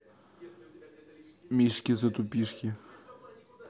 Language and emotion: Russian, neutral